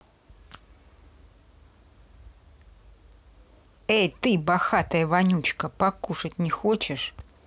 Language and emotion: Russian, angry